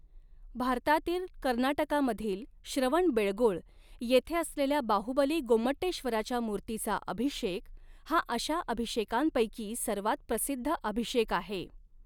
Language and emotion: Marathi, neutral